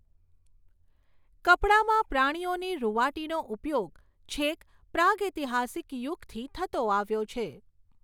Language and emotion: Gujarati, neutral